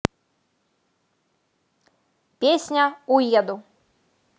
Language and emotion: Russian, positive